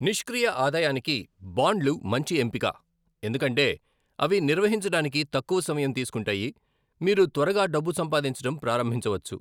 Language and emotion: Telugu, neutral